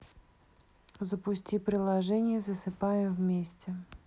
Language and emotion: Russian, neutral